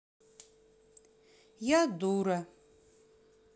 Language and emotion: Russian, sad